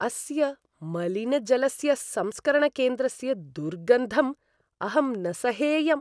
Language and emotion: Sanskrit, disgusted